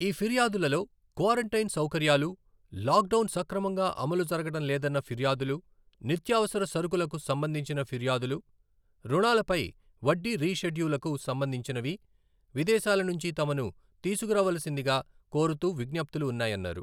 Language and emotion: Telugu, neutral